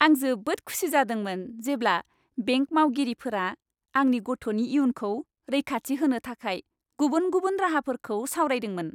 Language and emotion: Bodo, happy